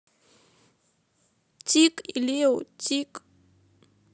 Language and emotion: Russian, sad